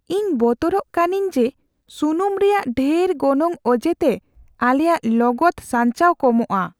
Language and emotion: Santali, fearful